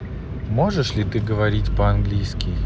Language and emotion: Russian, neutral